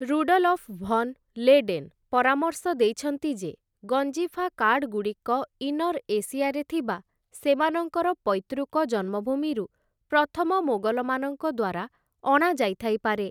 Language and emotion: Odia, neutral